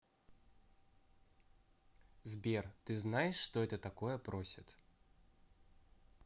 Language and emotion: Russian, neutral